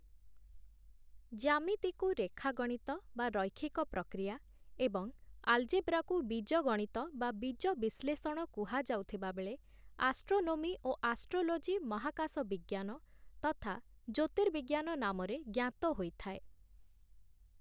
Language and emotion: Odia, neutral